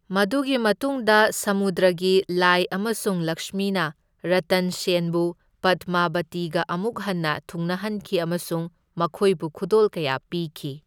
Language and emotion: Manipuri, neutral